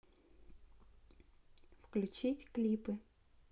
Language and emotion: Russian, neutral